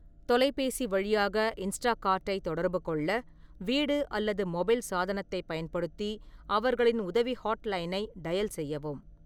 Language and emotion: Tamil, neutral